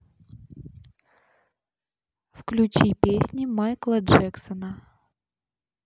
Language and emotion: Russian, neutral